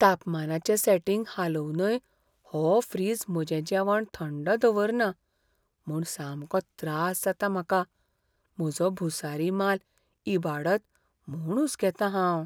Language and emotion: Goan Konkani, fearful